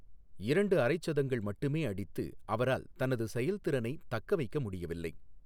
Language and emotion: Tamil, neutral